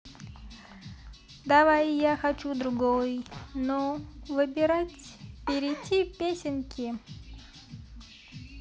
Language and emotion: Russian, positive